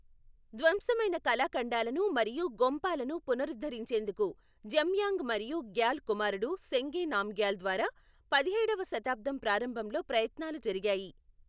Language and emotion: Telugu, neutral